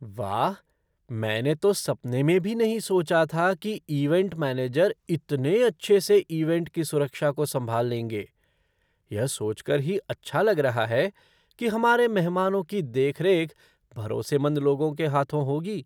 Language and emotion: Hindi, surprised